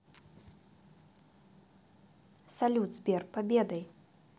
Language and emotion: Russian, neutral